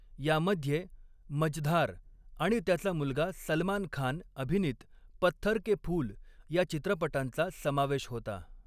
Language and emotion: Marathi, neutral